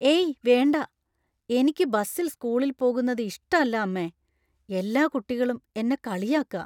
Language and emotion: Malayalam, fearful